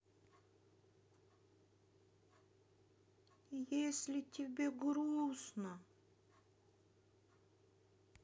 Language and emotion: Russian, sad